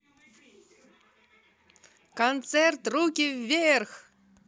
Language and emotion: Russian, positive